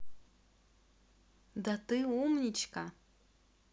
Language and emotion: Russian, positive